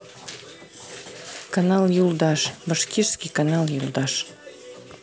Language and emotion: Russian, neutral